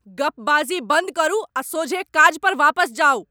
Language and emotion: Maithili, angry